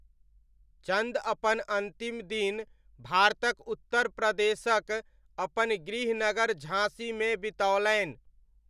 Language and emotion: Maithili, neutral